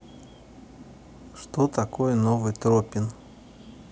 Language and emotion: Russian, neutral